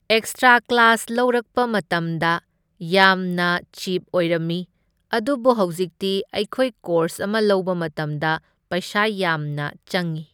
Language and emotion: Manipuri, neutral